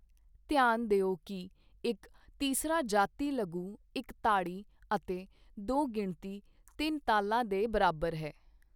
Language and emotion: Punjabi, neutral